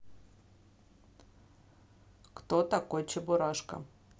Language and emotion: Russian, neutral